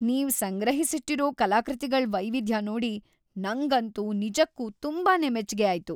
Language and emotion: Kannada, happy